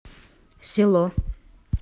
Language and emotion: Russian, neutral